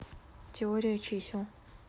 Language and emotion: Russian, neutral